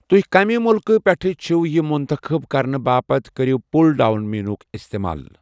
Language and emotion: Kashmiri, neutral